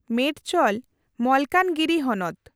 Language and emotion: Santali, neutral